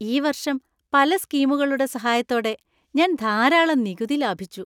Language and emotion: Malayalam, happy